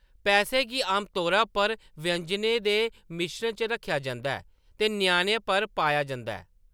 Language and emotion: Dogri, neutral